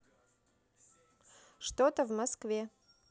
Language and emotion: Russian, neutral